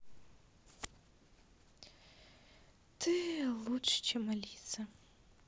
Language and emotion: Russian, sad